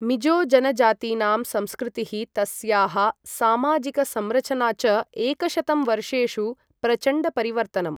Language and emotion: Sanskrit, neutral